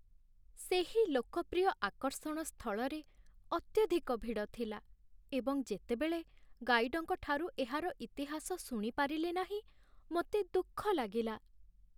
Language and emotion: Odia, sad